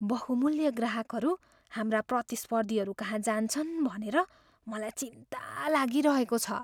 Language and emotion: Nepali, fearful